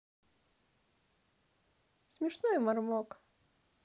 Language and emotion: Russian, positive